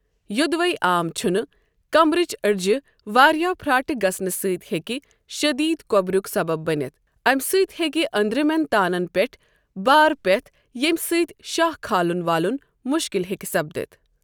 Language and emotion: Kashmiri, neutral